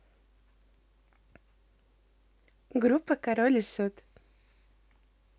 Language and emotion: Russian, neutral